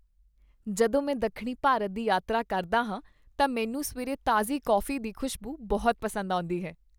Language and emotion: Punjabi, happy